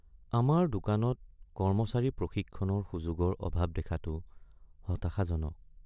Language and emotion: Assamese, sad